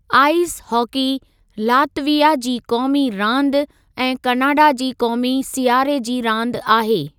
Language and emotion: Sindhi, neutral